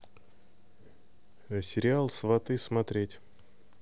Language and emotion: Russian, neutral